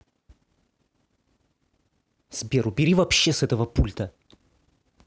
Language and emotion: Russian, angry